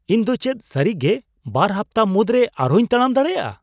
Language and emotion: Santali, surprised